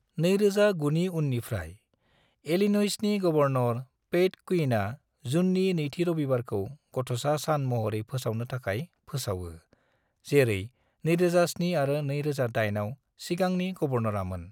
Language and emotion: Bodo, neutral